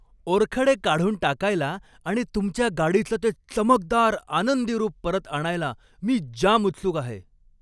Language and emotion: Marathi, happy